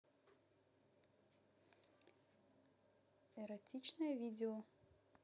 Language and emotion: Russian, neutral